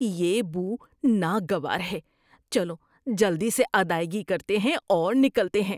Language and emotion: Urdu, disgusted